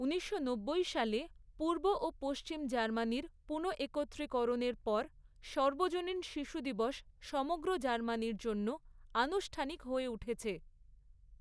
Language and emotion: Bengali, neutral